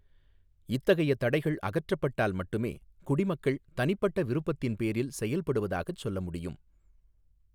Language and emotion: Tamil, neutral